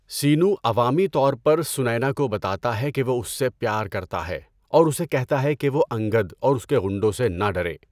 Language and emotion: Urdu, neutral